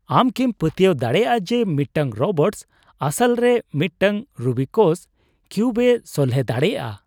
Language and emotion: Santali, surprised